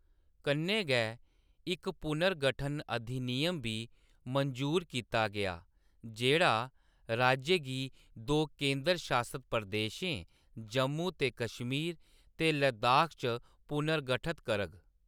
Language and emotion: Dogri, neutral